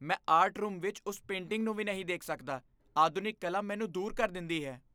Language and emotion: Punjabi, disgusted